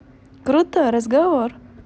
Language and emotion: Russian, positive